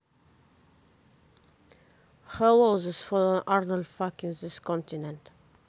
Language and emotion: Russian, neutral